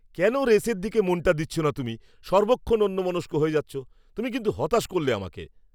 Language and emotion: Bengali, angry